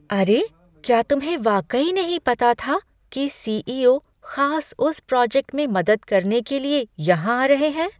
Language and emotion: Hindi, surprised